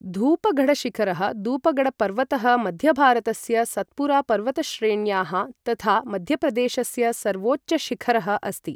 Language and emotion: Sanskrit, neutral